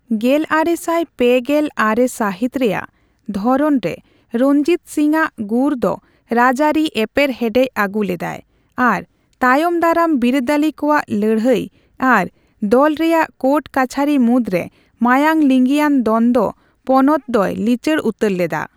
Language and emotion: Santali, neutral